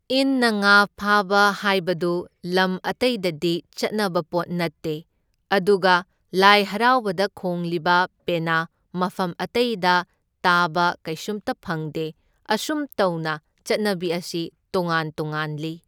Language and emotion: Manipuri, neutral